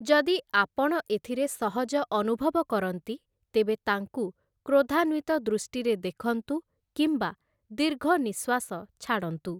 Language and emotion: Odia, neutral